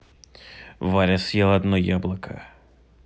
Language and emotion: Russian, neutral